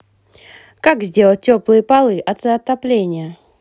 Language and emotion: Russian, positive